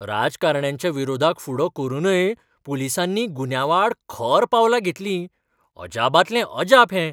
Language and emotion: Goan Konkani, surprised